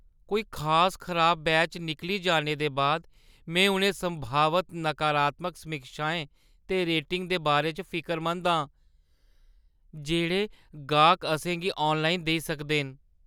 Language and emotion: Dogri, fearful